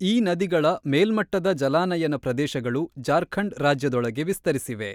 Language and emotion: Kannada, neutral